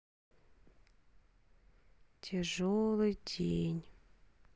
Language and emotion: Russian, sad